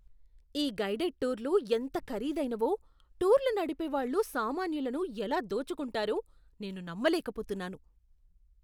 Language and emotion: Telugu, disgusted